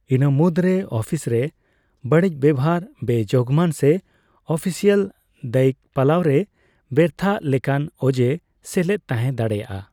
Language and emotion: Santali, neutral